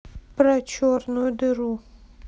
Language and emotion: Russian, neutral